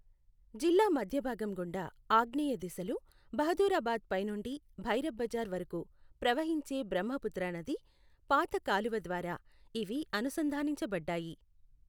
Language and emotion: Telugu, neutral